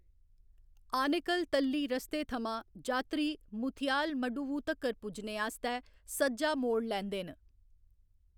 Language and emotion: Dogri, neutral